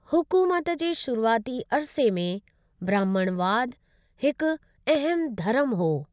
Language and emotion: Sindhi, neutral